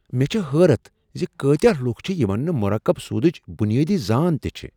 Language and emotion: Kashmiri, surprised